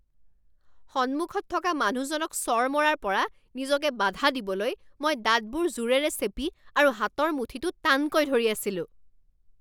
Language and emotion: Assamese, angry